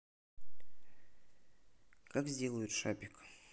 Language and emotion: Russian, neutral